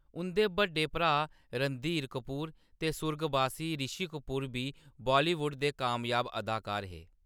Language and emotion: Dogri, neutral